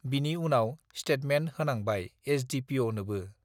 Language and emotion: Bodo, neutral